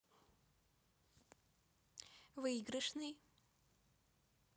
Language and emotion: Russian, neutral